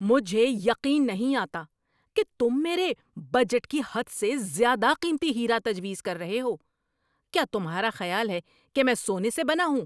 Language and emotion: Urdu, angry